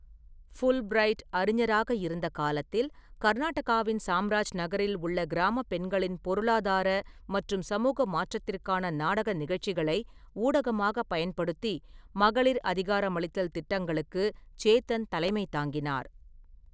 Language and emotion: Tamil, neutral